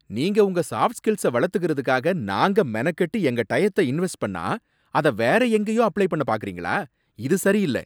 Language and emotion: Tamil, angry